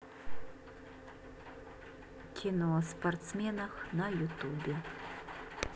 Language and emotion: Russian, neutral